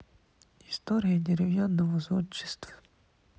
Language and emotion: Russian, neutral